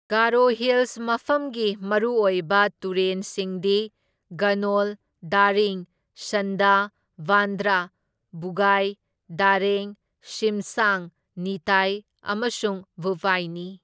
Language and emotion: Manipuri, neutral